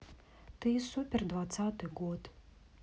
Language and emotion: Russian, neutral